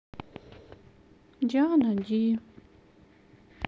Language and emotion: Russian, sad